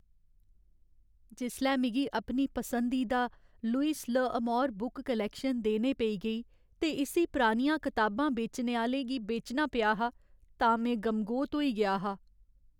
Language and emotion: Dogri, sad